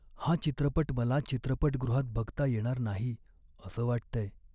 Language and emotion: Marathi, sad